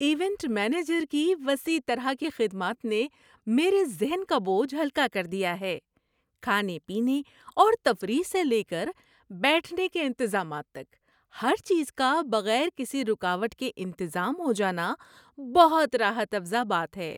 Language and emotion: Urdu, happy